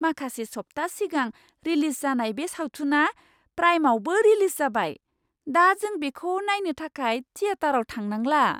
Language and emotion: Bodo, surprised